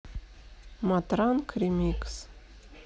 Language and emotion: Russian, neutral